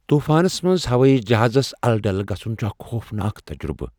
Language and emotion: Kashmiri, fearful